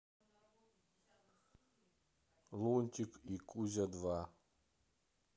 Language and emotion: Russian, neutral